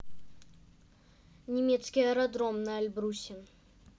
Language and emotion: Russian, neutral